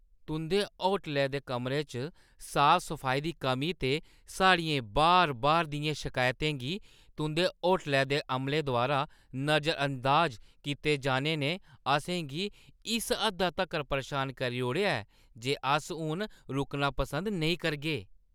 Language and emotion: Dogri, disgusted